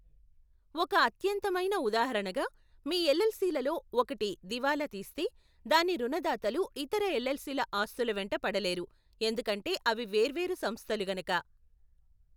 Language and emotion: Telugu, neutral